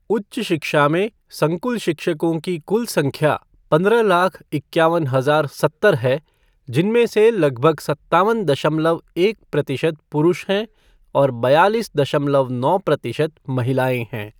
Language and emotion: Hindi, neutral